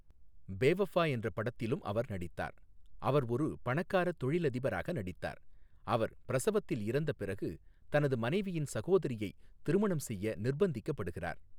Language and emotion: Tamil, neutral